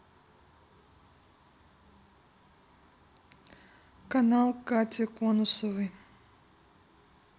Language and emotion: Russian, neutral